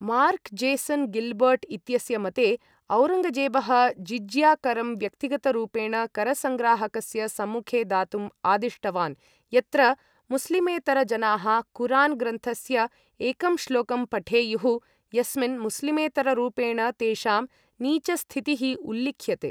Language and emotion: Sanskrit, neutral